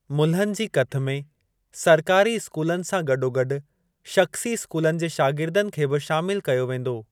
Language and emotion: Sindhi, neutral